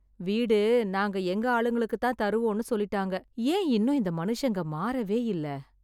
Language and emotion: Tamil, sad